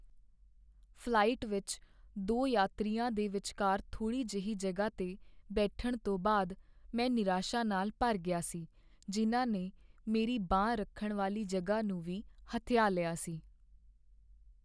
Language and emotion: Punjabi, sad